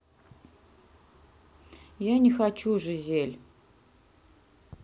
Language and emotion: Russian, sad